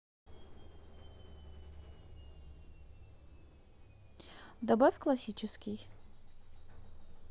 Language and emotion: Russian, neutral